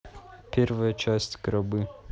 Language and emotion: Russian, neutral